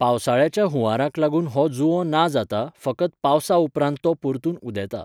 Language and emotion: Goan Konkani, neutral